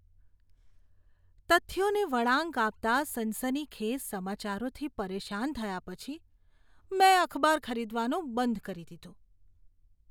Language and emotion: Gujarati, disgusted